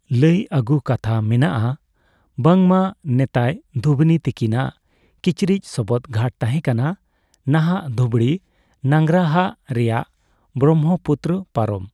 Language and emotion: Santali, neutral